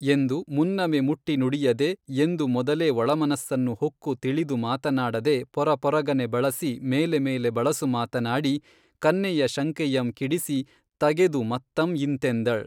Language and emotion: Kannada, neutral